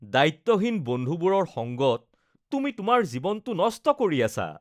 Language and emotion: Assamese, disgusted